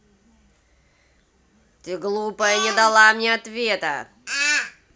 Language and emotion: Russian, angry